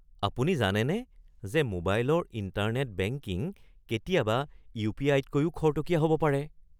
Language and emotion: Assamese, surprised